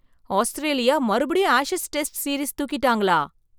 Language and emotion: Tamil, surprised